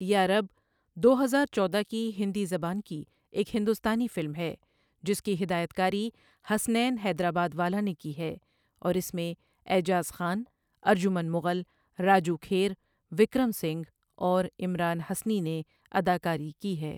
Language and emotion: Urdu, neutral